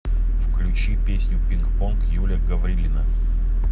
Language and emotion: Russian, neutral